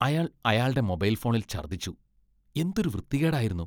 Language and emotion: Malayalam, disgusted